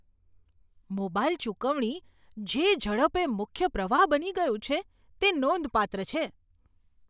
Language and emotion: Gujarati, surprised